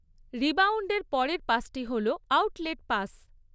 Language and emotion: Bengali, neutral